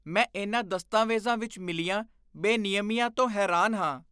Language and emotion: Punjabi, disgusted